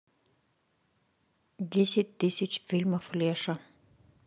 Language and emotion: Russian, neutral